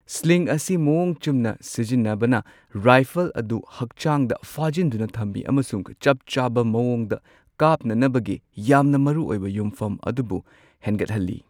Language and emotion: Manipuri, neutral